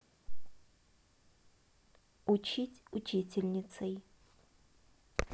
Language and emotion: Russian, neutral